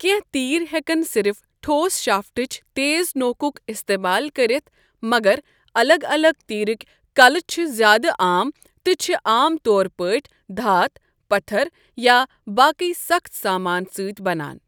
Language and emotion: Kashmiri, neutral